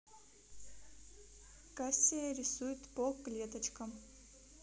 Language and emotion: Russian, neutral